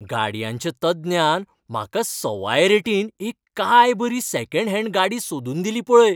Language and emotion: Goan Konkani, happy